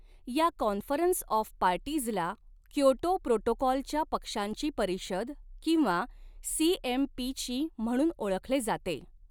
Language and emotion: Marathi, neutral